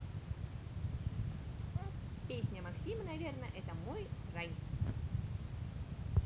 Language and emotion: Russian, positive